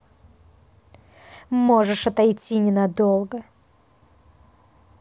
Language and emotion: Russian, angry